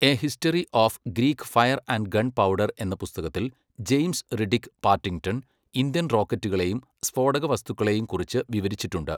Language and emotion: Malayalam, neutral